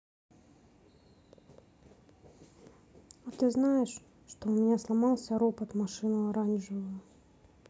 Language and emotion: Russian, sad